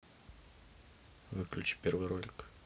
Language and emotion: Russian, neutral